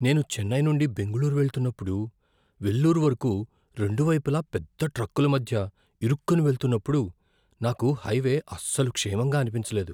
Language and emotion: Telugu, fearful